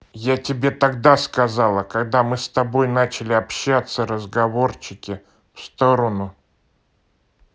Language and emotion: Russian, angry